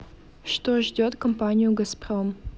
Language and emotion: Russian, neutral